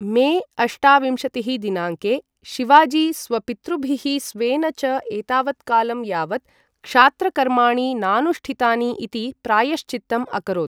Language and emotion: Sanskrit, neutral